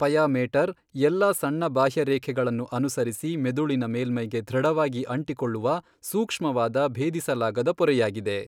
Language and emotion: Kannada, neutral